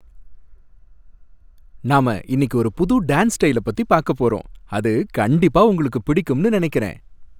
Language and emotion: Tamil, happy